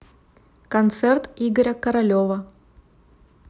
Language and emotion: Russian, neutral